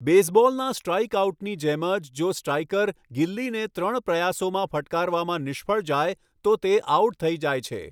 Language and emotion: Gujarati, neutral